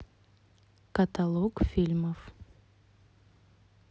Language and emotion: Russian, neutral